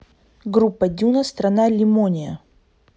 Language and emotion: Russian, neutral